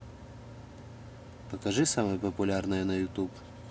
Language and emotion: Russian, neutral